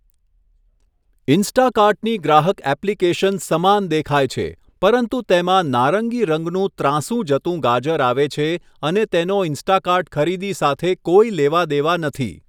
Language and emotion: Gujarati, neutral